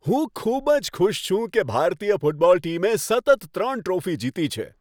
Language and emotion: Gujarati, happy